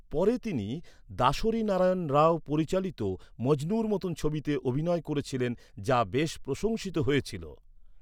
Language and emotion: Bengali, neutral